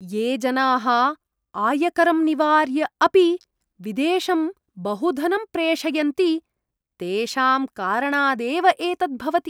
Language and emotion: Sanskrit, disgusted